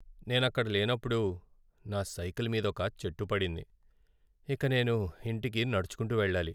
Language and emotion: Telugu, sad